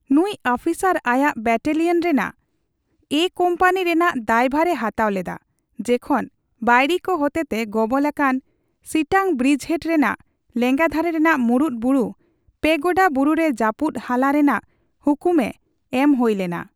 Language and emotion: Santali, neutral